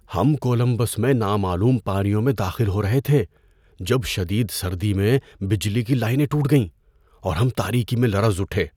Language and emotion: Urdu, fearful